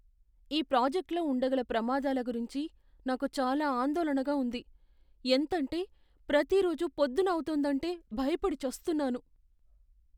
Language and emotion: Telugu, fearful